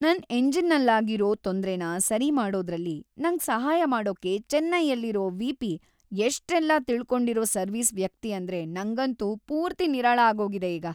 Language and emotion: Kannada, happy